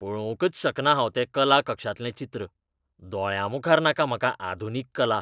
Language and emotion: Goan Konkani, disgusted